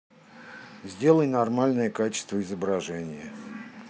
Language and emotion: Russian, neutral